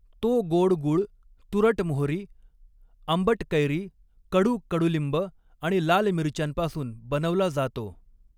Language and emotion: Marathi, neutral